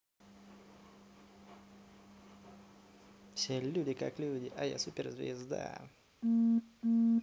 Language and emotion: Russian, positive